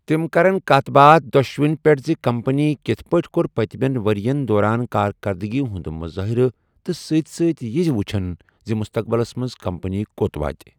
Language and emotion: Kashmiri, neutral